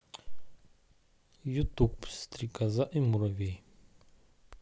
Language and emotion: Russian, neutral